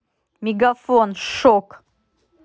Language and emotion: Russian, angry